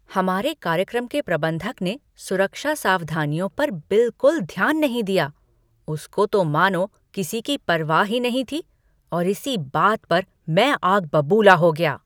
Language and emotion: Hindi, angry